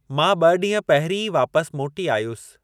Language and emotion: Sindhi, neutral